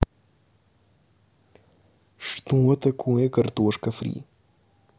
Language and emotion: Russian, neutral